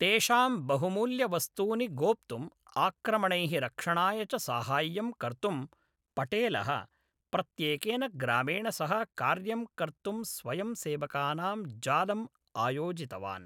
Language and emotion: Sanskrit, neutral